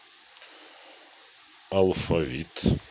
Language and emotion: Russian, neutral